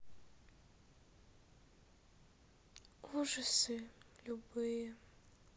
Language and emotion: Russian, sad